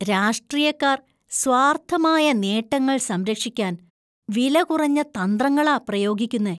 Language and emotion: Malayalam, disgusted